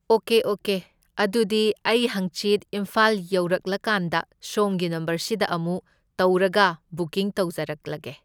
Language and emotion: Manipuri, neutral